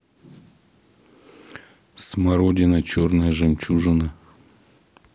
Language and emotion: Russian, neutral